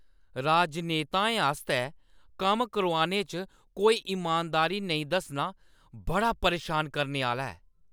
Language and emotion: Dogri, angry